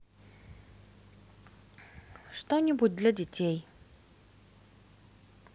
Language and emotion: Russian, neutral